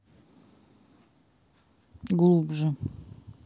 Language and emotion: Russian, neutral